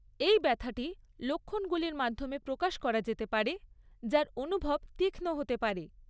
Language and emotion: Bengali, neutral